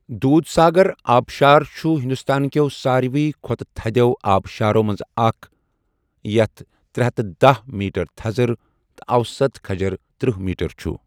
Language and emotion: Kashmiri, neutral